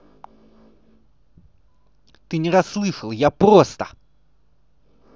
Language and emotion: Russian, angry